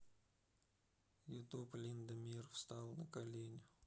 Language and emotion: Russian, neutral